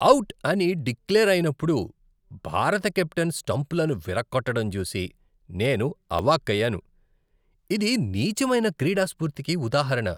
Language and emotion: Telugu, disgusted